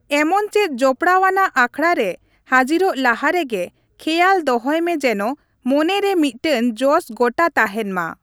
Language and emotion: Santali, neutral